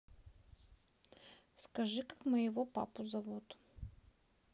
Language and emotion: Russian, neutral